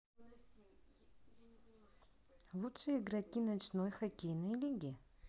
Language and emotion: Russian, neutral